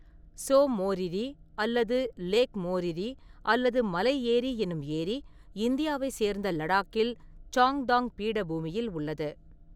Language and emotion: Tamil, neutral